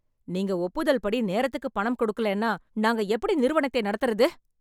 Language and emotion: Tamil, angry